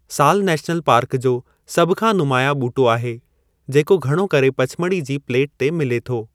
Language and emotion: Sindhi, neutral